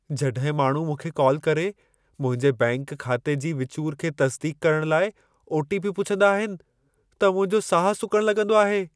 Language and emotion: Sindhi, fearful